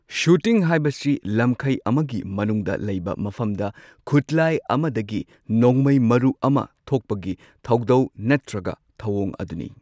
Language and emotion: Manipuri, neutral